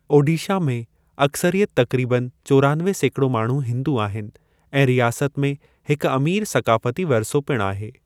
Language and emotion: Sindhi, neutral